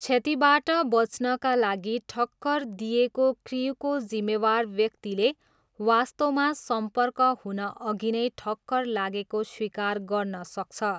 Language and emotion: Nepali, neutral